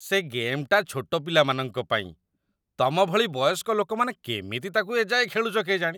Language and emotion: Odia, disgusted